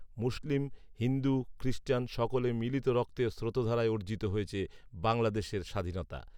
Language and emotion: Bengali, neutral